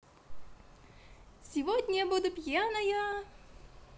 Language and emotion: Russian, positive